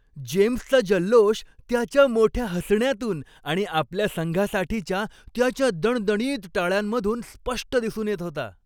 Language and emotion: Marathi, happy